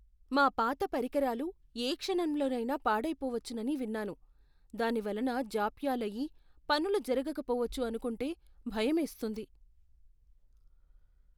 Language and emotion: Telugu, fearful